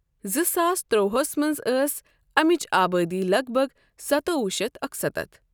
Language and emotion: Kashmiri, neutral